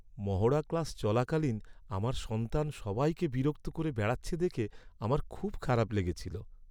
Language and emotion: Bengali, sad